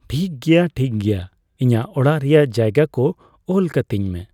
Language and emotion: Santali, neutral